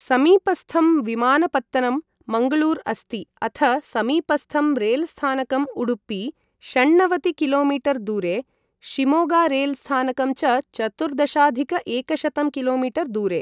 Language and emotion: Sanskrit, neutral